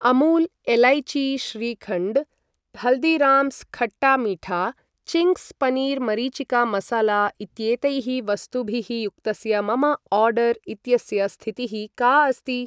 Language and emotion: Sanskrit, neutral